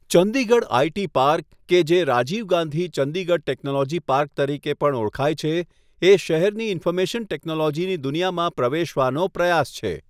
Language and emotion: Gujarati, neutral